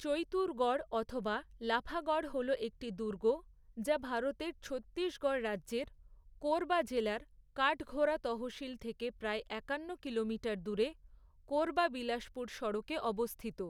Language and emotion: Bengali, neutral